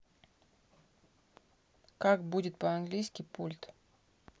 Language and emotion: Russian, neutral